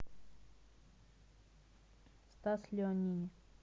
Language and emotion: Russian, neutral